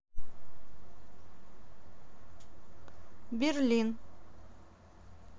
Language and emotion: Russian, neutral